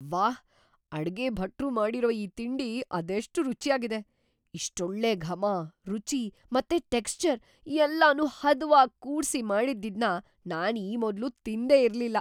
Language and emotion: Kannada, surprised